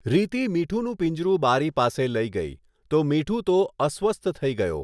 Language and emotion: Gujarati, neutral